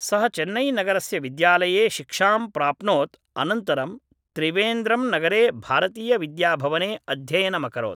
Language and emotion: Sanskrit, neutral